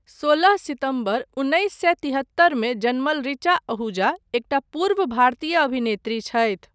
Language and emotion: Maithili, neutral